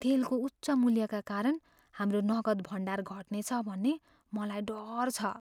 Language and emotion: Nepali, fearful